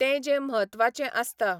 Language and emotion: Goan Konkani, neutral